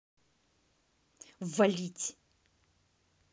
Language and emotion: Russian, angry